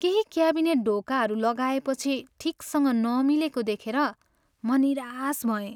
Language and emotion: Nepali, sad